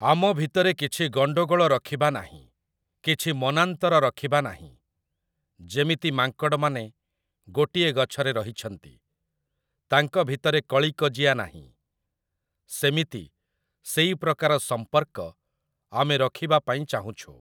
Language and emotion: Odia, neutral